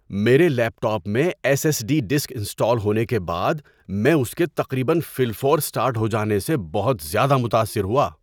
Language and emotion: Urdu, surprised